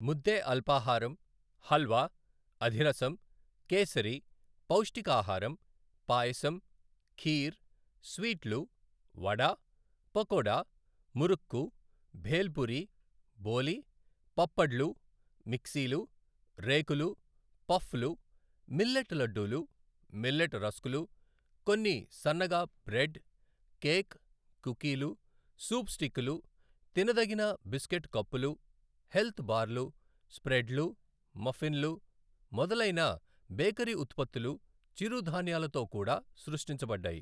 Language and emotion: Telugu, neutral